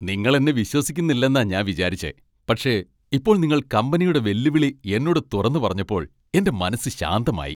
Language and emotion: Malayalam, happy